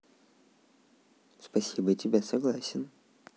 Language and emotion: Russian, neutral